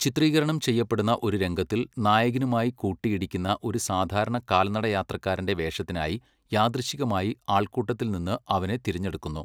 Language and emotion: Malayalam, neutral